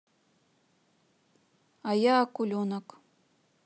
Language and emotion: Russian, neutral